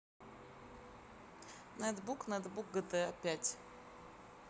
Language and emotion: Russian, neutral